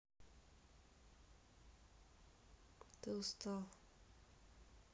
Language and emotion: Russian, sad